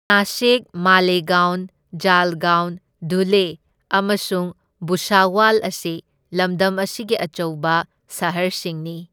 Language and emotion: Manipuri, neutral